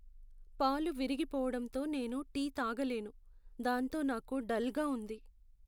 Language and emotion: Telugu, sad